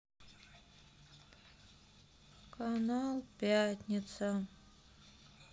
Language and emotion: Russian, sad